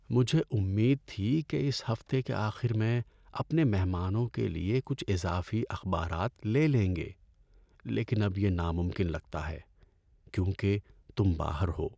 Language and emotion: Urdu, sad